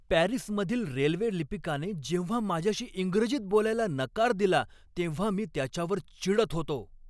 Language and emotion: Marathi, angry